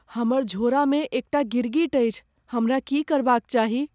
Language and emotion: Maithili, fearful